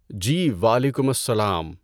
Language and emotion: Urdu, neutral